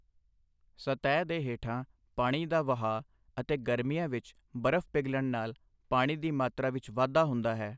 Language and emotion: Punjabi, neutral